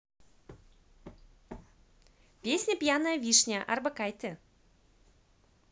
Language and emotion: Russian, positive